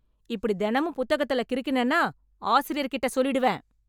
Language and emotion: Tamil, angry